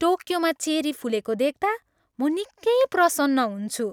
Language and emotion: Nepali, happy